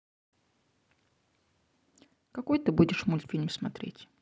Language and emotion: Russian, neutral